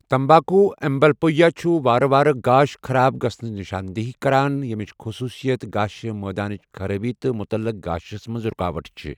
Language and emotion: Kashmiri, neutral